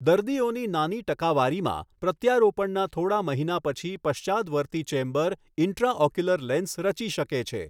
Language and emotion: Gujarati, neutral